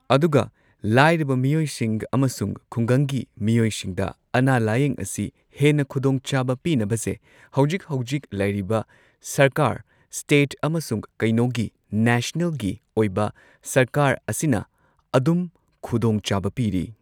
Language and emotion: Manipuri, neutral